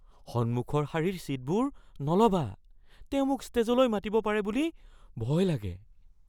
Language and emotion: Assamese, fearful